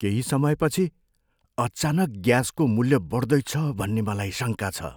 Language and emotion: Nepali, fearful